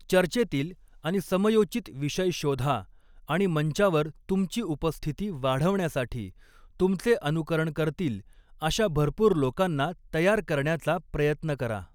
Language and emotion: Marathi, neutral